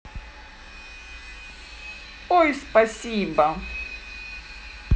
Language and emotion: Russian, positive